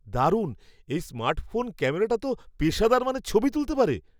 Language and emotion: Bengali, surprised